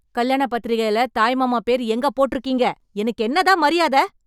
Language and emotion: Tamil, angry